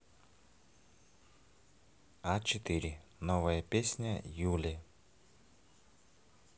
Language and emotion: Russian, neutral